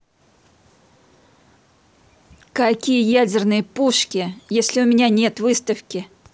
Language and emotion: Russian, angry